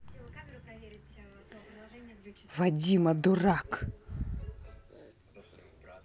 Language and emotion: Russian, angry